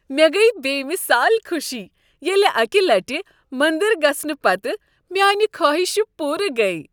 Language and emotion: Kashmiri, happy